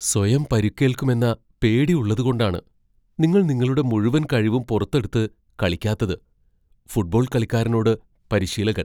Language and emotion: Malayalam, fearful